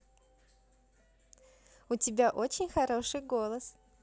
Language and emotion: Russian, positive